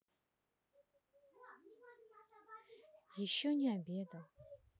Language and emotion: Russian, sad